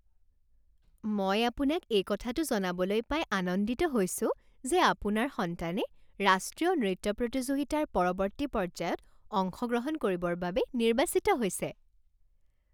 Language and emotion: Assamese, happy